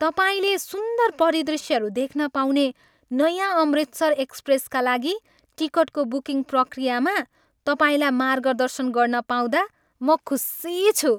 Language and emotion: Nepali, happy